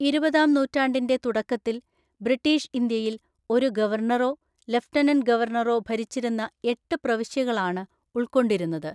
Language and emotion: Malayalam, neutral